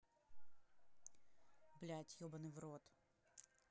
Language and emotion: Russian, angry